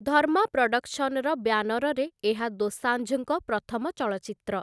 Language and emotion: Odia, neutral